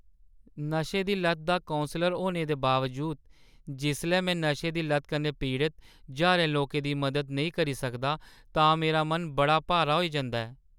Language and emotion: Dogri, sad